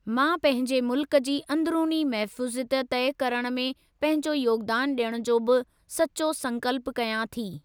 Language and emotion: Sindhi, neutral